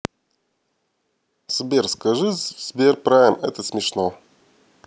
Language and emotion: Russian, neutral